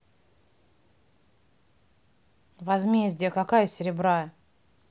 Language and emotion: Russian, neutral